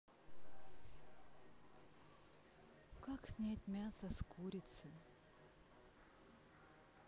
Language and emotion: Russian, sad